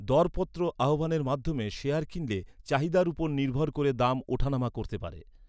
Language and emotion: Bengali, neutral